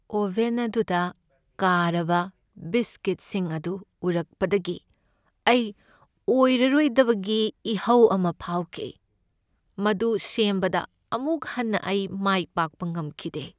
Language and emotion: Manipuri, sad